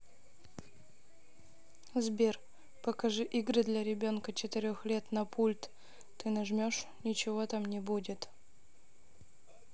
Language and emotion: Russian, neutral